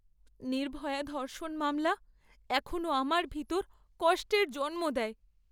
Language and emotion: Bengali, sad